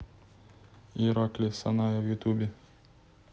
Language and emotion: Russian, neutral